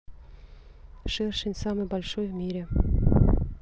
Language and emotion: Russian, neutral